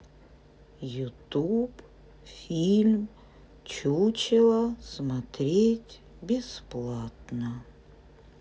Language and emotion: Russian, sad